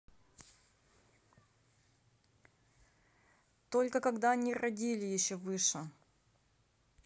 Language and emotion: Russian, neutral